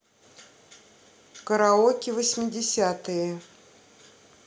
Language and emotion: Russian, neutral